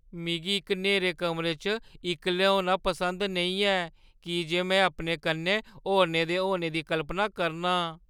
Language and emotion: Dogri, fearful